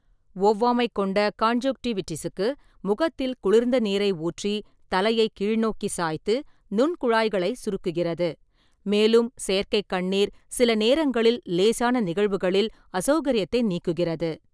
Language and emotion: Tamil, neutral